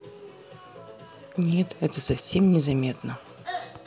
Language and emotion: Russian, neutral